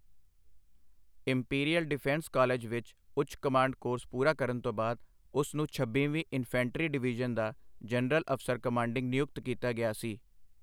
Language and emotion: Punjabi, neutral